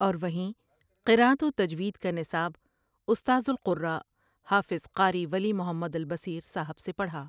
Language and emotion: Urdu, neutral